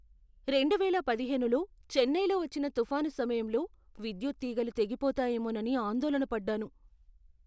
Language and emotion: Telugu, fearful